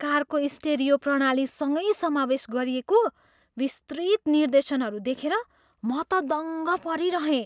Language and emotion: Nepali, surprised